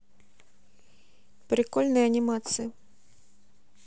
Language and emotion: Russian, neutral